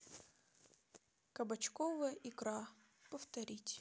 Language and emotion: Russian, neutral